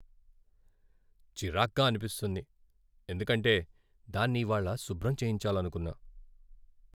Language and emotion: Telugu, sad